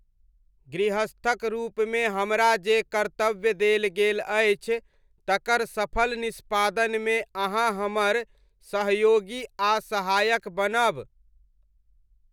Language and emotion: Maithili, neutral